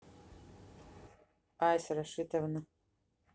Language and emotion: Russian, neutral